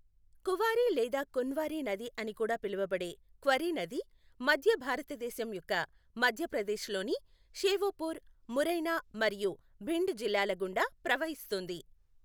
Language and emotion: Telugu, neutral